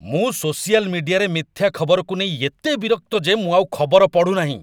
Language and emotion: Odia, angry